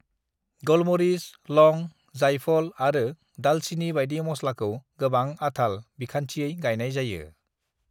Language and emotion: Bodo, neutral